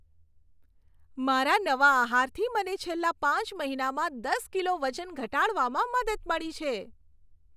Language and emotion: Gujarati, happy